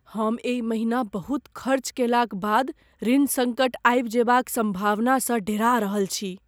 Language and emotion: Maithili, fearful